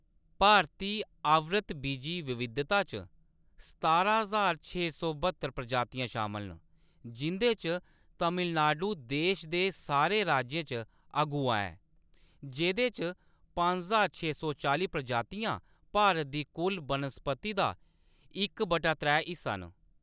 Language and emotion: Dogri, neutral